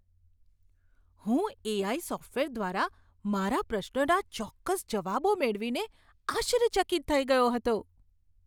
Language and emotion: Gujarati, surprised